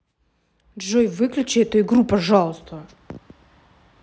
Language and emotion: Russian, angry